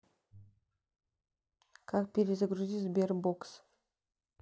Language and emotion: Russian, neutral